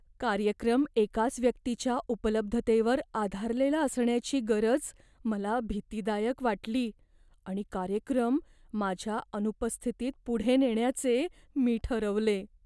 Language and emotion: Marathi, fearful